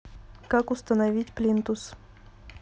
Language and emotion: Russian, neutral